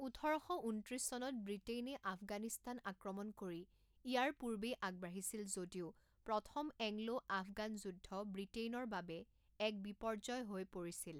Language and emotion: Assamese, neutral